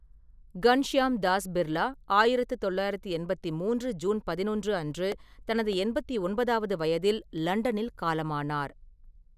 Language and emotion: Tamil, neutral